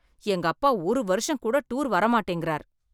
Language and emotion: Tamil, angry